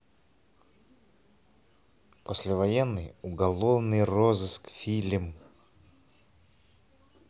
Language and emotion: Russian, neutral